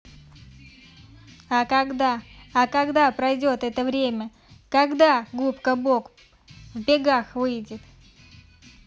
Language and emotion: Russian, neutral